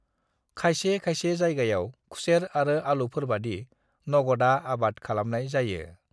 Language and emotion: Bodo, neutral